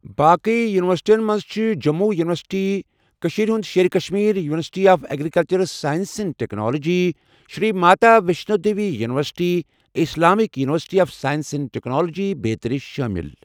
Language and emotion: Kashmiri, neutral